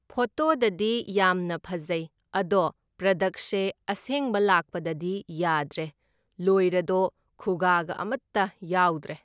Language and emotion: Manipuri, neutral